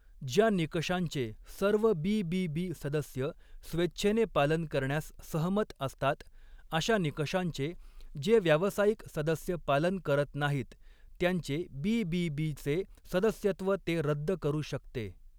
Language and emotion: Marathi, neutral